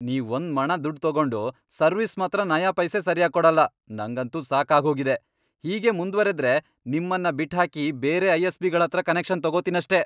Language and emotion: Kannada, angry